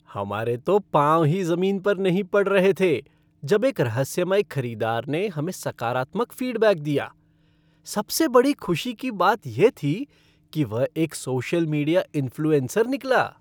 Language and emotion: Hindi, happy